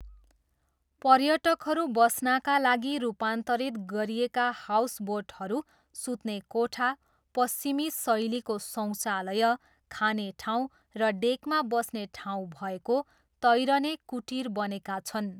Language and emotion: Nepali, neutral